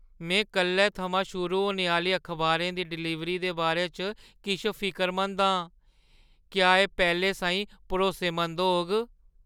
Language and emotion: Dogri, fearful